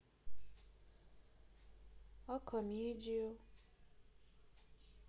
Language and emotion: Russian, sad